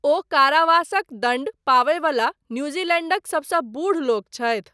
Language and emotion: Maithili, neutral